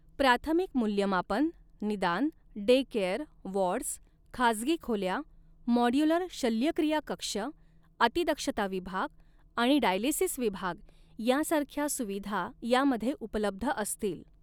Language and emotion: Marathi, neutral